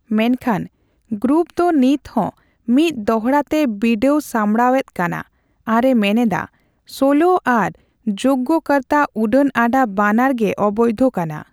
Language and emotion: Santali, neutral